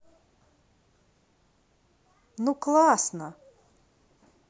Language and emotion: Russian, positive